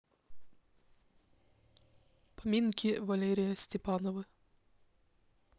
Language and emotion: Russian, neutral